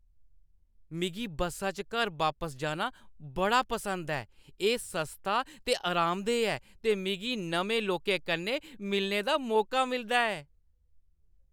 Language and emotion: Dogri, happy